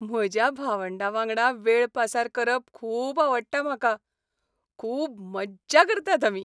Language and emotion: Goan Konkani, happy